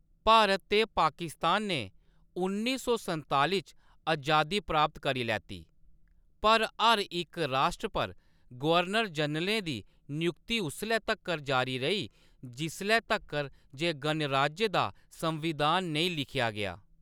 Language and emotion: Dogri, neutral